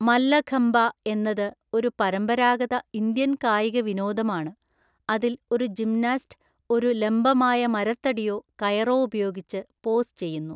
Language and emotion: Malayalam, neutral